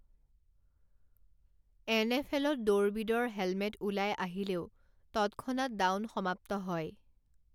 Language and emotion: Assamese, neutral